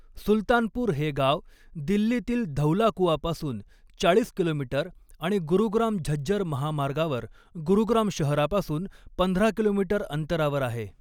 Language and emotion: Marathi, neutral